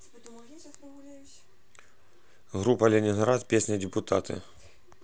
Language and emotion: Russian, neutral